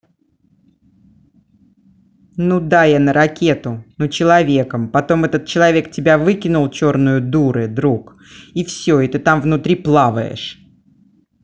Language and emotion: Russian, angry